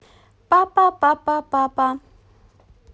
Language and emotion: Russian, positive